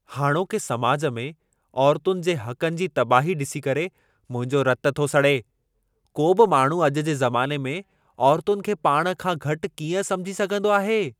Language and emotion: Sindhi, angry